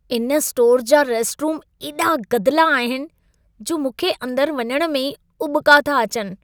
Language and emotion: Sindhi, disgusted